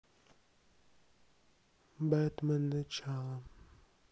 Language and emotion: Russian, neutral